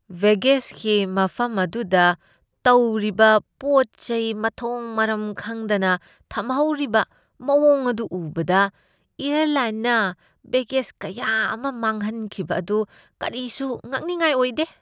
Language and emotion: Manipuri, disgusted